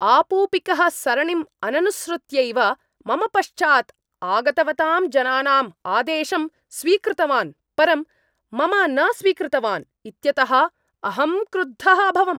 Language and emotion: Sanskrit, angry